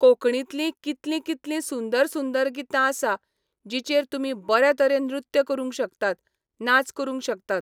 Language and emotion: Goan Konkani, neutral